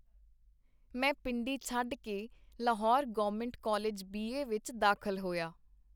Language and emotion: Punjabi, neutral